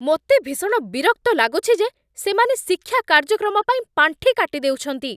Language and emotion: Odia, angry